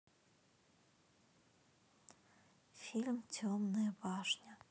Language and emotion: Russian, neutral